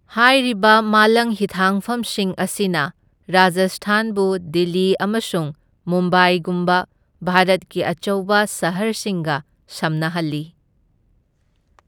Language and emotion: Manipuri, neutral